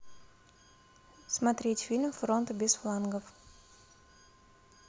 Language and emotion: Russian, neutral